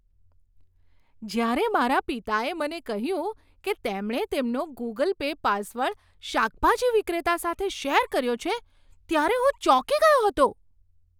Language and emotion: Gujarati, surprised